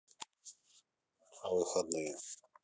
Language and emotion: Russian, neutral